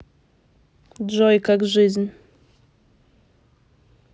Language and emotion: Russian, neutral